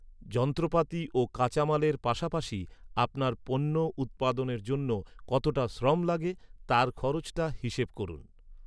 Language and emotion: Bengali, neutral